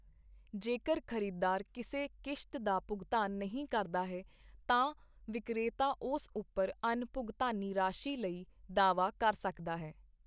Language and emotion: Punjabi, neutral